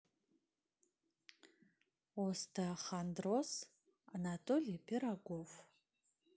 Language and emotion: Russian, neutral